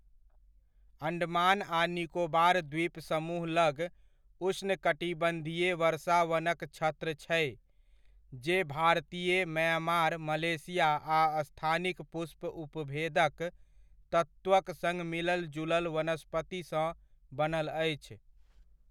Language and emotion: Maithili, neutral